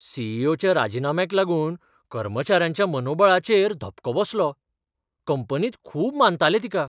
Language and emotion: Goan Konkani, surprised